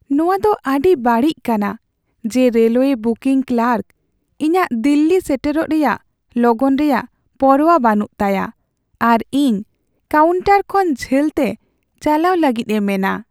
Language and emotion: Santali, sad